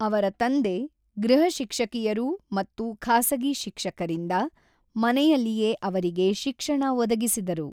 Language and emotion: Kannada, neutral